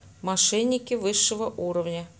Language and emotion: Russian, neutral